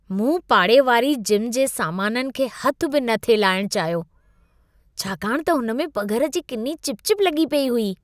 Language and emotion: Sindhi, disgusted